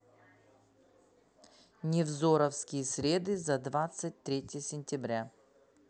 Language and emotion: Russian, neutral